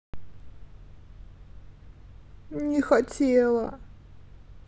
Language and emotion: Russian, sad